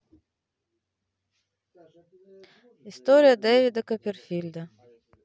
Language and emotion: Russian, neutral